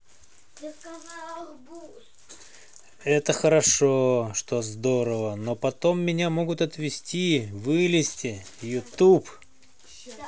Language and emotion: Russian, positive